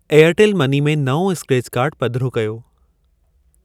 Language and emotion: Sindhi, neutral